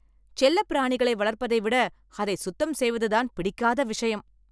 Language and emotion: Tamil, angry